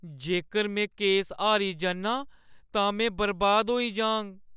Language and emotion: Dogri, fearful